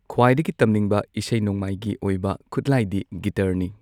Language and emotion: Manipuri, neutral